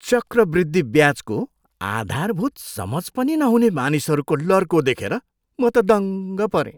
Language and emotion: Nepali, surprised